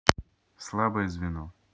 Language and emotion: Russian, neutral